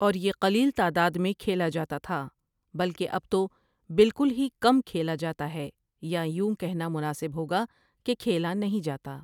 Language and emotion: Urdu, neutral